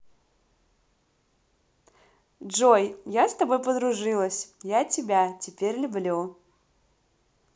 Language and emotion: Russian, positive